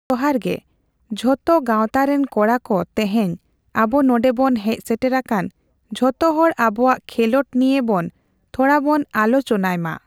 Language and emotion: Santali, neutral